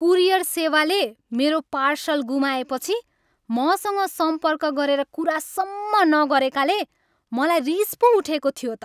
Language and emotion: Nepali, angry